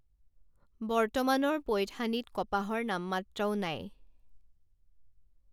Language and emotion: Assamese, neutral